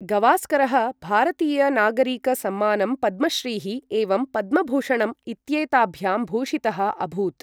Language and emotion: Sanskrit, neutral